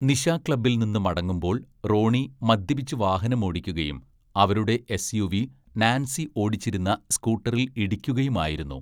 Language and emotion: Malayalam, neutral